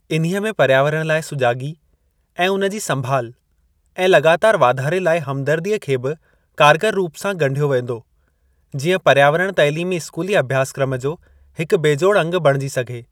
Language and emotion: Sindhi, neutral